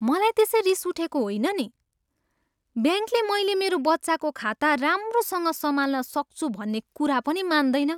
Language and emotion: Nepali, disgusted